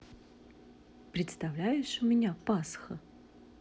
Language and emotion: Russian, neutral